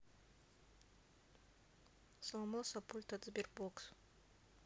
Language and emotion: Russian, neutral